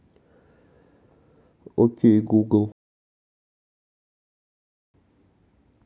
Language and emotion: Russian, neutral